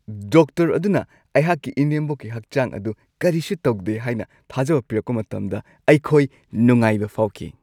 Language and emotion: Manipuri, happy